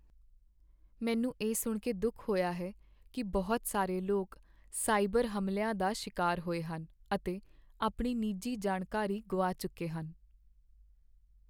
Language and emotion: Punjabi, sad